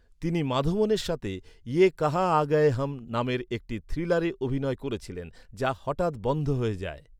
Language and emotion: Bengali, neutral